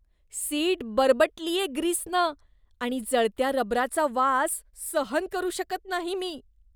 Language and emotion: Marathi, disgusted